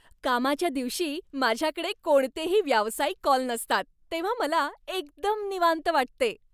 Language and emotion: Marathi, happy